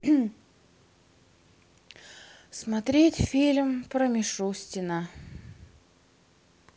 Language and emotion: Russian, sad